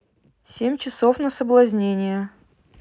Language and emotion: Russian, neutral